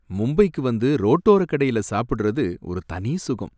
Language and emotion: Tamil, happy